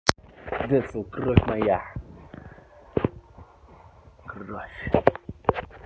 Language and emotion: Russian, neutral